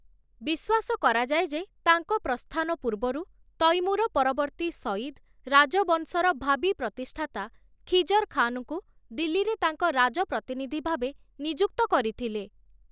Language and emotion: Odia, neutral